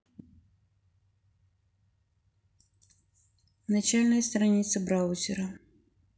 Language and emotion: Russian, neutral